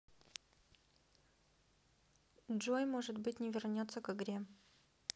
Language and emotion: Russian, sad